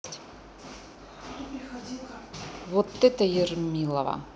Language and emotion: Russian, neutral